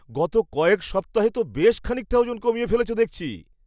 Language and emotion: Bengali, surprised